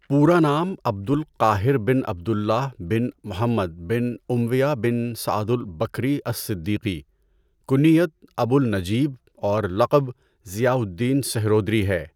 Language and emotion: Urdu, neutral